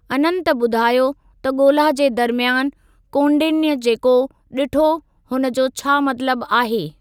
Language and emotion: Sindhi, neutral